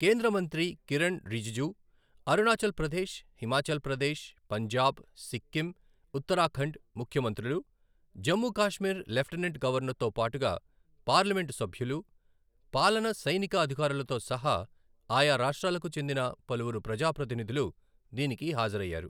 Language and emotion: Telugu, neutral